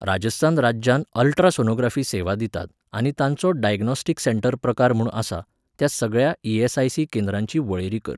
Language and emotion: Goan Konkani, neutral